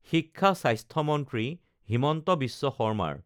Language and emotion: Assamese, neutral